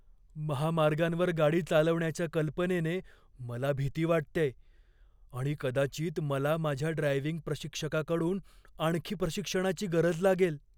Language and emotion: Marathi, fearful